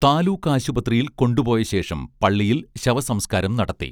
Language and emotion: Malayalam, neutral